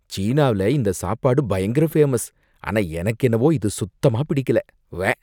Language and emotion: Tamil, disgusted